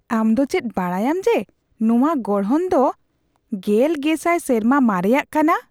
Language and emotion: Santali, surprised